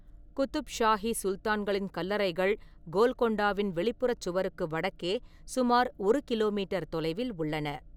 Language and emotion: Tamil, neutral